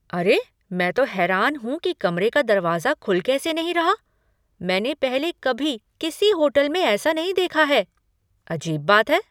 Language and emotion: Hindi, surprised